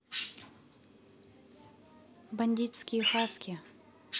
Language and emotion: Russian, neutral